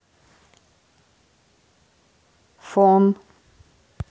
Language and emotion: Russian, neutral